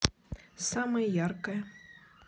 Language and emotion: Russian, neutral